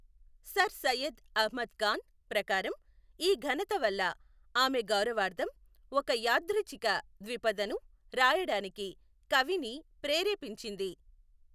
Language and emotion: Telugu, neutral